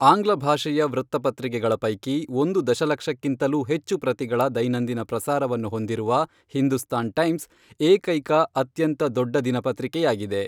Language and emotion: Kannada, neutral